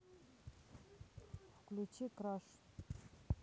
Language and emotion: Russian, neutral